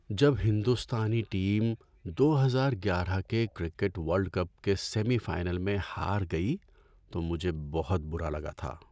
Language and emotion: Urdu, sad